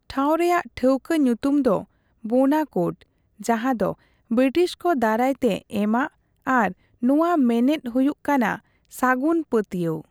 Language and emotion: Santali, neutral